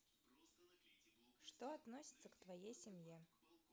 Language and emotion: Russian, neutral